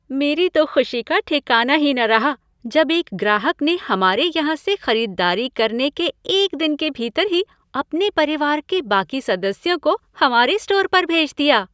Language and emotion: Hindi, happy